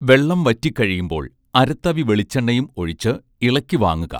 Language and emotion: Malayalam, neutral